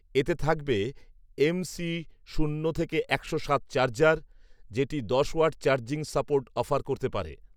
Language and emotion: Bengali, neutral